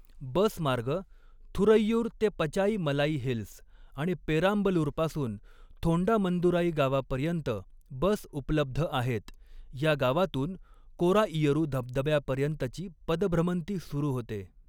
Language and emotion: Marathi, neutral